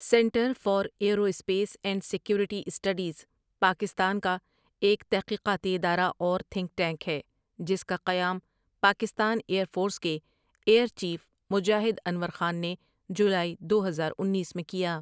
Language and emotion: Urdu, neutral